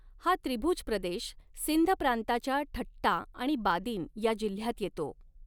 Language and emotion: Marathi, neutral